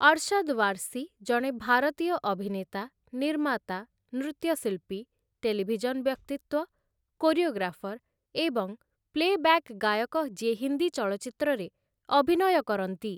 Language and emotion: Odia, neutral